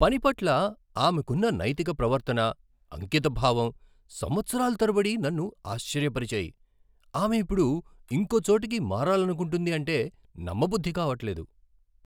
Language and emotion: Telugu, surprised